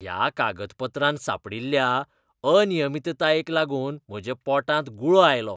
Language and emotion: Goan Konkani, disgusted